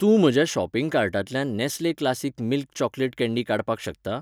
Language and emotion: Goan Konkani, neutral